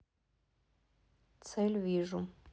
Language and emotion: Russian, neutral